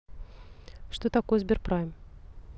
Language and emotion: Russian, neutral